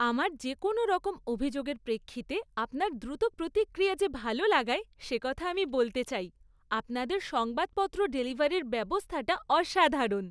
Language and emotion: Bengali, happy